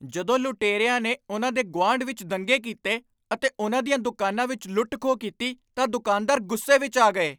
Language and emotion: Punjabi, angry